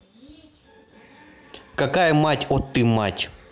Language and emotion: Russian, angry